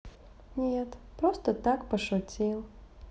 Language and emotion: Russian, sad